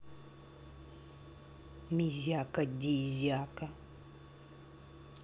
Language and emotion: Russian, neutral